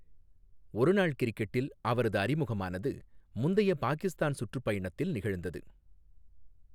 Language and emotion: Tamil, neutral